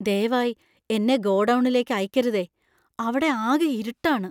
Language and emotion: Malayalam, fearful